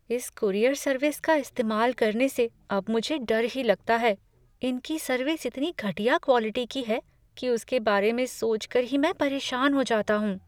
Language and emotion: Hindi, fearful